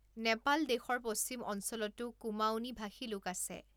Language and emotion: Assamese, neutral